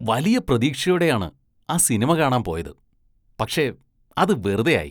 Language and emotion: Malayalam, disgusted